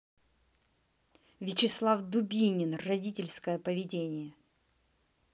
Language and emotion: Russian, angry